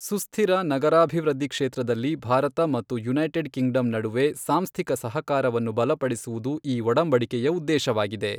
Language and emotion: Kannada, neutral